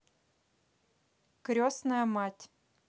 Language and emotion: Russian, neutral